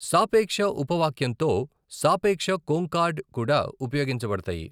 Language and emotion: Telugu, neutral